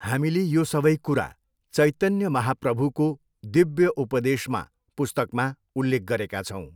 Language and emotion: Nepali, neutral